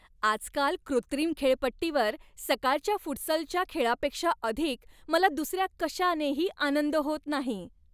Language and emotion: Marathi, happy